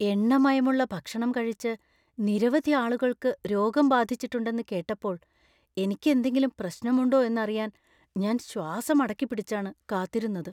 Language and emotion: Malayalam, fearful